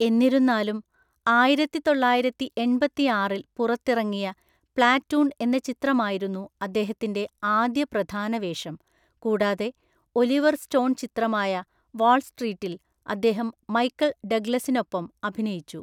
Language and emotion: Malayalam, neutral